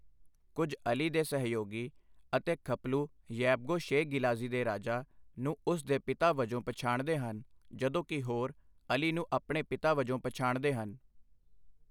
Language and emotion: Punjabi, neutral